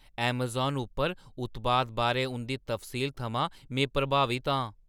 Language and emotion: Dogri, surprised